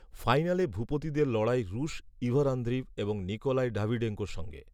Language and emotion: Bengali, neutral